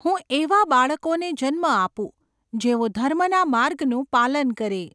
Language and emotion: Gujarati, neutral